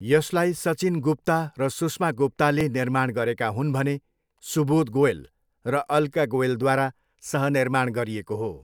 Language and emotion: Nepali, neutral